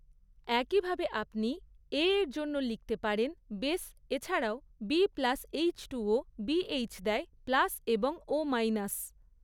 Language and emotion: Bengali, neutral